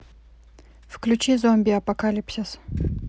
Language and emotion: Russian, neutral